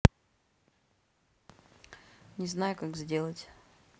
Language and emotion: Russian, sad